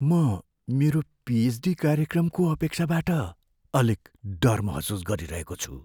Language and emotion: Nepali, fearful